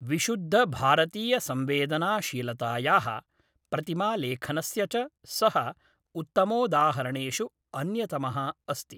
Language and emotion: Sanskrit, neutral